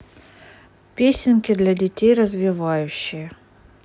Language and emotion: Russian, neutral